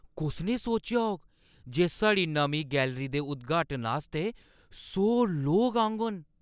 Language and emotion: Dogri, surprised